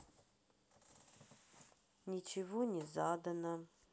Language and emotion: Russian, sad